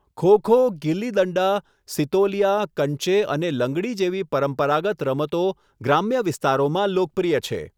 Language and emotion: Gujarati, neutral